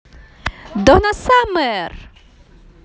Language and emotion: Russian, positive